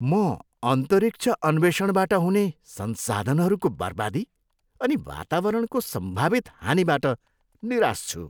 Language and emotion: Nepali, disgusted